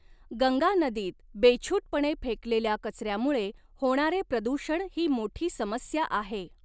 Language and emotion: Marathi, neutral